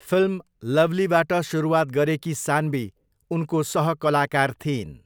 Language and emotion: Nepali, neutral